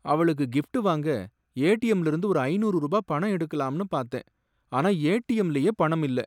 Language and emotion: Tamil, sad